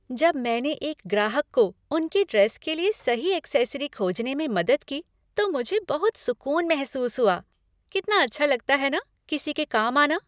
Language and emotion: Hindi, happy